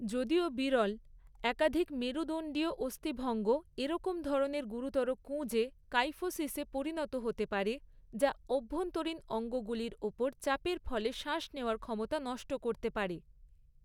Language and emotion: Bengali, neutral